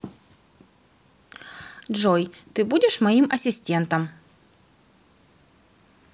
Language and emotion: Russian, neutral